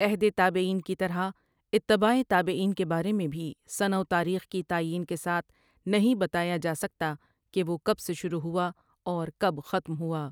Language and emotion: Urdu, neutral